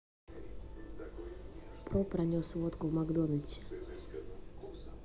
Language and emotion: Russian, neutral